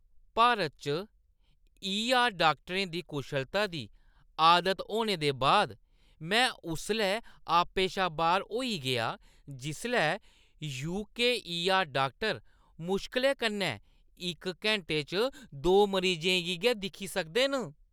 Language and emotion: Dogri, disgusted